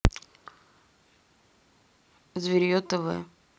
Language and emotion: Russian, neutral